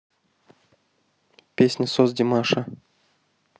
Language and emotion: Russian, neutral